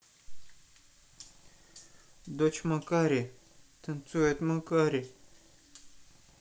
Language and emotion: Russian, sad